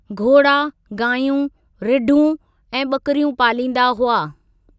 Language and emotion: Sindhi, neutral